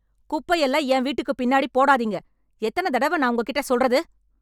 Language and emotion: Tamil, angry